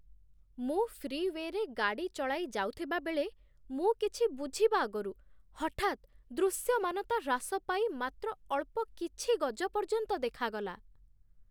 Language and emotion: Odia, surprised